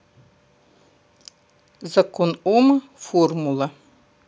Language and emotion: Russian, neutral